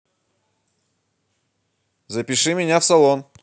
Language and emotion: Russian, positive